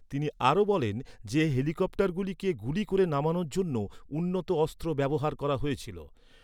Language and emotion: Bengali, neutral